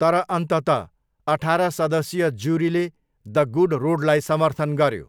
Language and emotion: Nepali, neutral